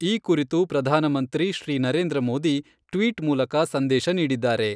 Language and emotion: Kannada, neutral